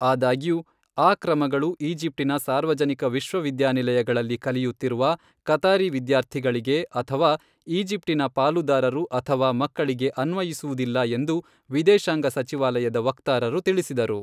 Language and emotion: Kannada, neutral